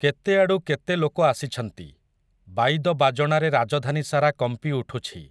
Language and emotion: Odia, neutral